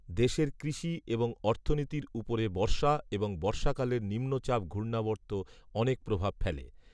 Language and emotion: Bengali, neutral